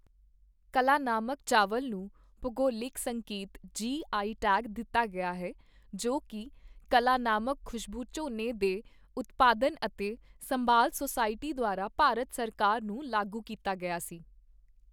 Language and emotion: Punjabi, neutral